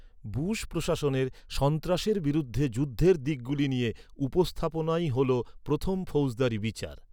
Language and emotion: Bengali, neutral